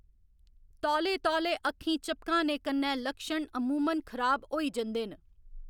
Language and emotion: Dogri, neutral